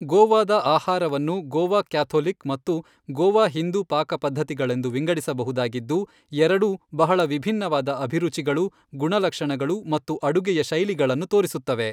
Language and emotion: Kannada, neutral